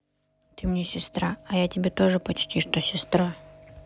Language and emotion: Russian, neutral